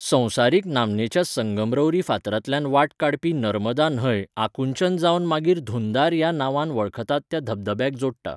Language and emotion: Goan Konkani, neutral